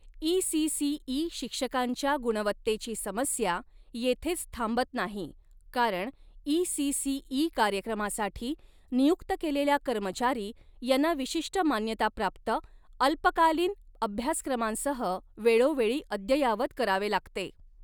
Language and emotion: Marathi, neutral